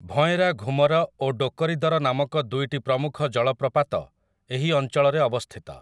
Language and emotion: Odia, neutral